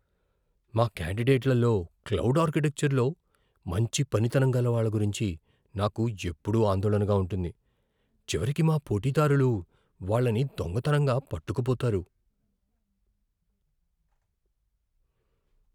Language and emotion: Telugu, fearful